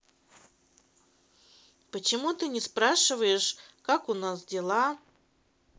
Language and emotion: Russian, neutral